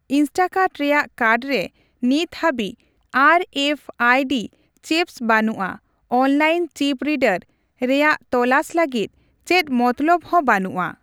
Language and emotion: Santali, neutral